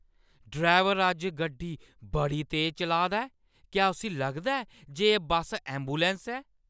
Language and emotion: Dogri, angry